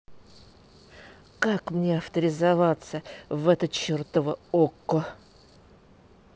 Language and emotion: Russian, angry